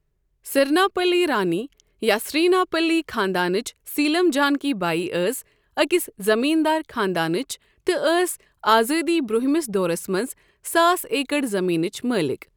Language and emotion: Kashmiri, neutral